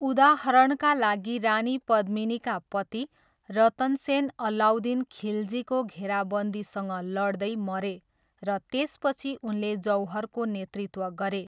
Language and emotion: Nepali, neutral